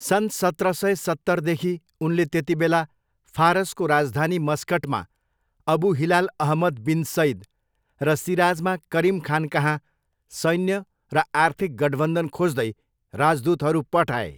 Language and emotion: Nepali, neutral